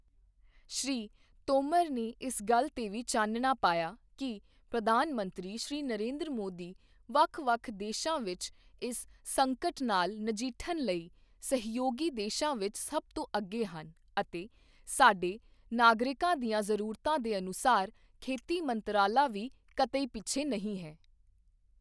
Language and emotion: Punjabi, neutral